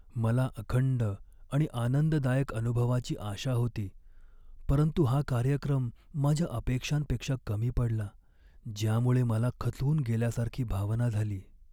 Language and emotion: Marathi, sad